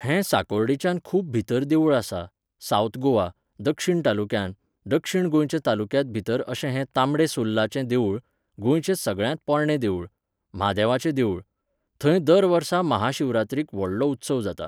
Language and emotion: Goan Konkani, neutral